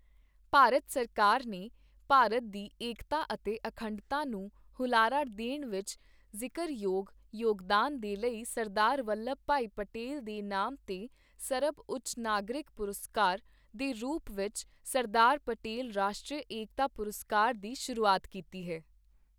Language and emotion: Punjabi, neutral